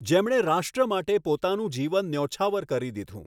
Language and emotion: Gujarati, neutral